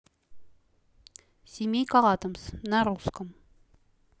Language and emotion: Russian, neutral